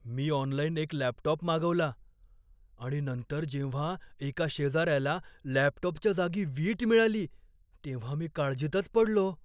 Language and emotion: Marathi, fearful